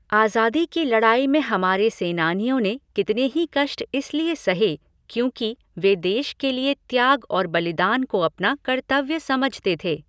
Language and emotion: Hindi, neutral